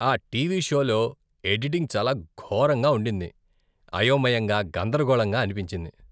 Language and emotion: Telugu, disgusted